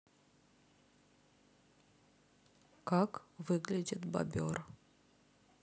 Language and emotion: Russian, neutral